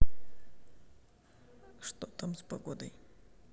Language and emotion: Russian, neutral